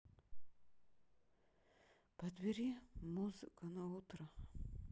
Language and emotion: Russian, sad